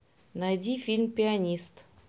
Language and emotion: Russian, neutral